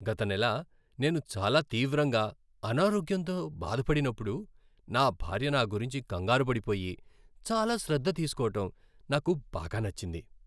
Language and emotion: Telugu, happy